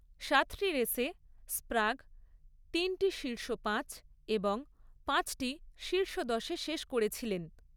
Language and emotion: Bengali, neutral